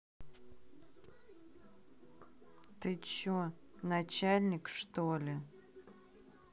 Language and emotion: Russian, angry